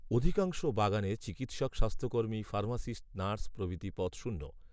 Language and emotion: Bengali, neutral